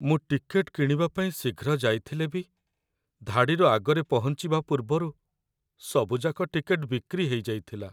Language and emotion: Odia, sad